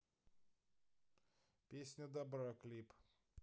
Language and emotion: Russian, neutral